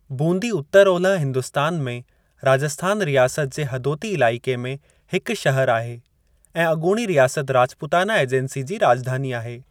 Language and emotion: Sindhi, neutral